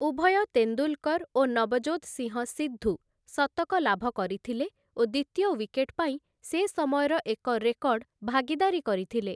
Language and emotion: Odia, neutral